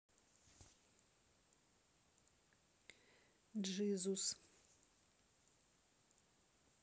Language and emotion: Russian, neutral